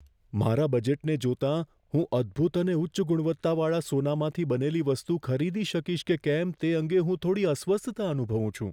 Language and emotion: Gujarati, fearful